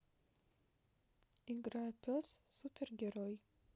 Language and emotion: Russian, neutral